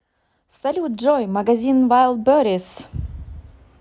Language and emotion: Russian, positive